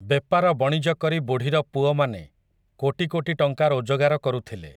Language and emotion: Odia, neutral